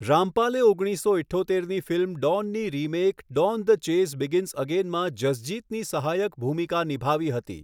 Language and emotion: Gujarati, neutral